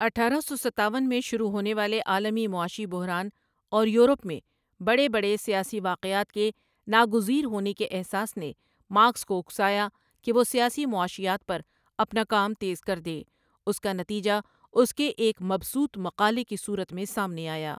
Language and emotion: Urdu, neutral